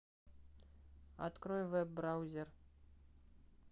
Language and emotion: Russian, neutral